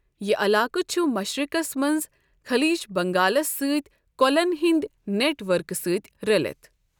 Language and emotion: Kashmiri, neutral